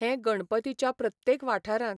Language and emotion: Goan Konkani, neutral